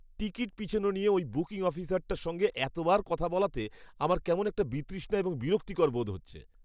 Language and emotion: Bengali, disgusted